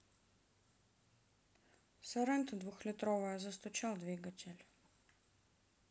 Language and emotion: Russian, sad